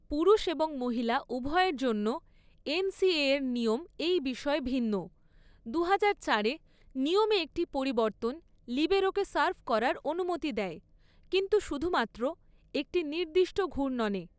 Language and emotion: Bengali, neutral